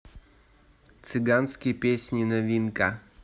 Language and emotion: Russian, neutral